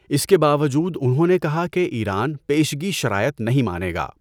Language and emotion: Urdu, neutral